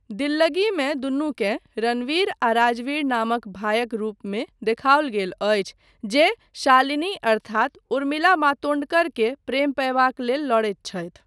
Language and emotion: Maithili, neutral